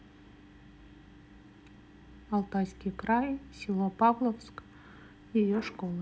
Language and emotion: Russian, neutral